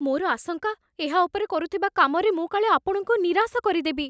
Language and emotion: Odia, fearful